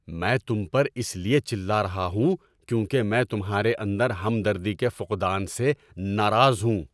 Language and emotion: Urdu, angry